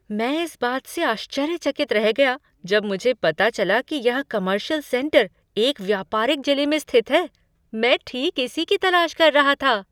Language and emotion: Hindi, surprised